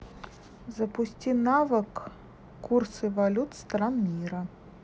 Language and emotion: Russian, neutral